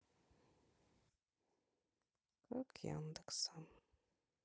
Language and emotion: Russian, sad